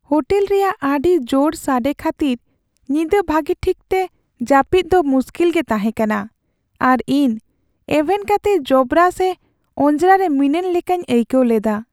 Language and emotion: Santali, sad